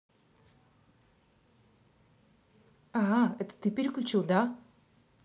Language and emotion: Russian, angry